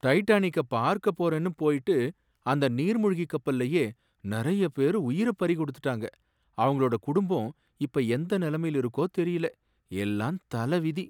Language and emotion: Tamil, sad